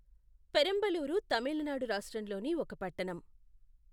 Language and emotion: Telugu, neutral